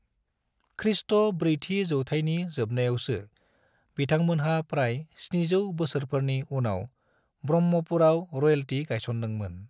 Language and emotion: Bodo, neutral